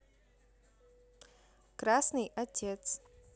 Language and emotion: Russian, neutral